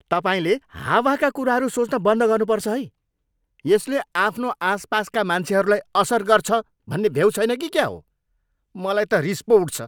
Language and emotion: Nepali, angry